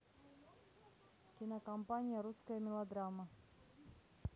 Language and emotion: Russian, neutral